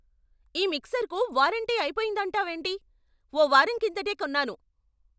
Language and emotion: Telugu, angry